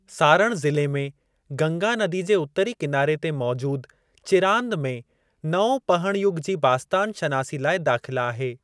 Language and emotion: Sindhi, neutral